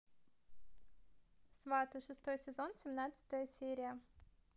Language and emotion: Russian, positive